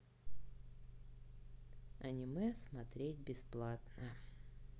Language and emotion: Russian, sad